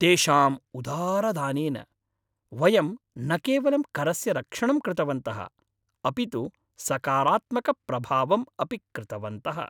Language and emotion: Sanskrit, happy